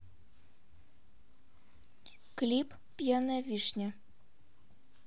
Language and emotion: Russian, neutral